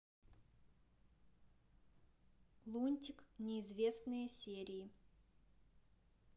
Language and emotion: Russian, neutral